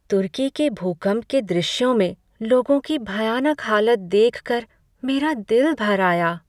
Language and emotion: Hindi, sad